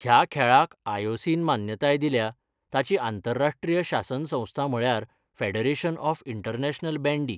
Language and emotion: Goan Konkani, neutral